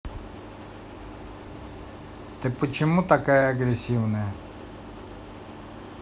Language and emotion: Russian, neutral